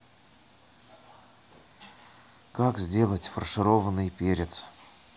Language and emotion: Russian, sad